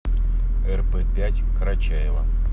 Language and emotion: Russian, neutral